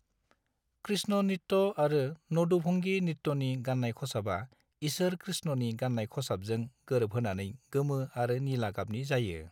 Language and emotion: Bodo, neutral